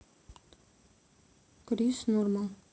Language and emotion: Russian, neutral